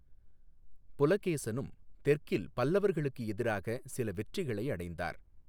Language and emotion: Tamil, neutral